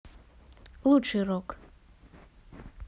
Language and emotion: Russian, neutral